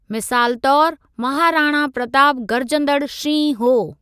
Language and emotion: Sindhi, neutral